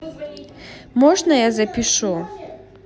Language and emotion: Russian, neutral